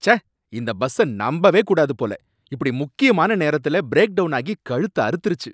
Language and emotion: Tamil, angry